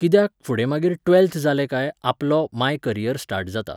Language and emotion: Goan Konkani, neutral